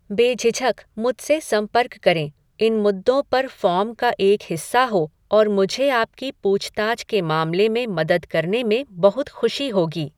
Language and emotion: Hindi, neutral